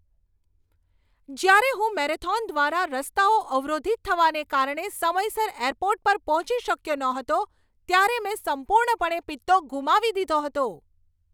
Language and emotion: Gujarati, angry